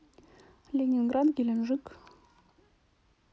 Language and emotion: Russian, neutral